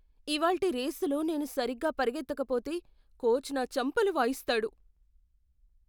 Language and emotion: Telugu, fearful